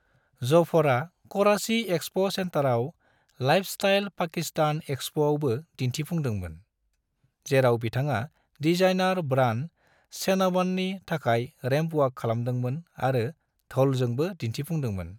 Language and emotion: Bodo, neutral